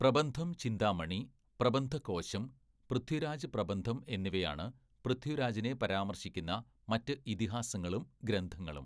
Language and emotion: Malayalam, neutral